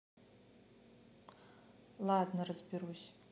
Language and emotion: Russian, neutral